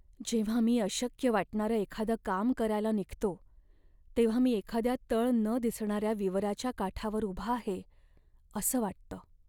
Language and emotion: Marathi, sad